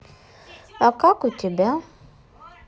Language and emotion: Russian, neutral